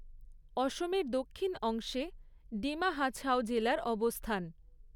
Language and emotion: Bengali, neutral